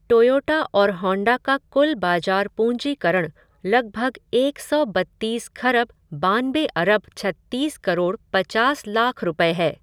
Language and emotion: Hindi, neutral